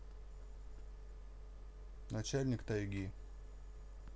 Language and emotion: Russian, neutral